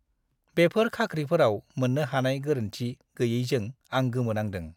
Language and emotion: Bodo, disgusted